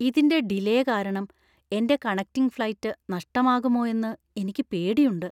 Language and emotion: Malayalam, fearful